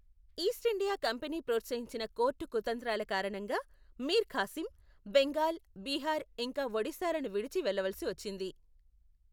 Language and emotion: Telugu, neutral